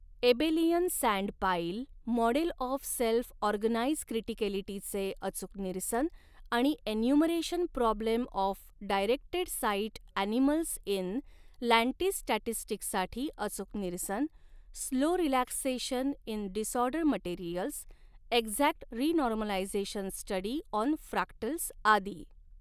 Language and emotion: Marathi, neutral